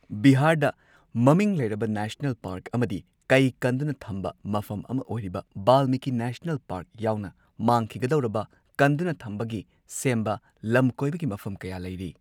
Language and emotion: Manipuri, neutral